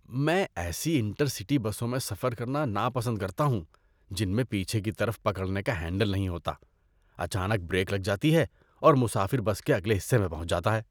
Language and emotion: Urdu, disgusted